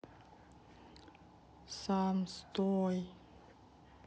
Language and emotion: Russian, sad